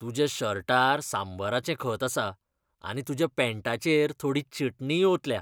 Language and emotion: Goan Konkani, disgusted